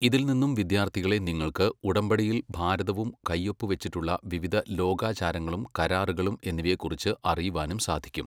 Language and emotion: Malayalam, neutral